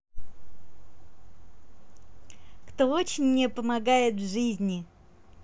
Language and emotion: Russian, positive